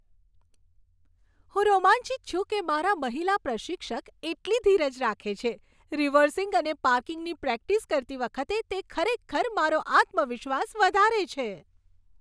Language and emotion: Gujarati, happy